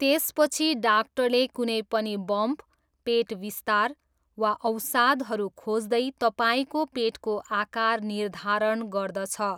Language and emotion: Nepali, neutral